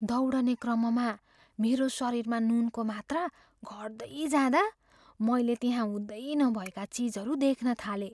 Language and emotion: Nepali, fearful